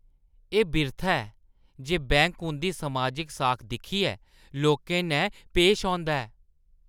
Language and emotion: Dogri, disgusted